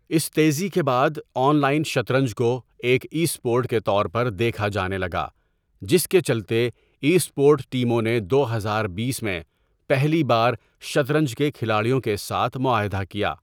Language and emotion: Urdu, neutral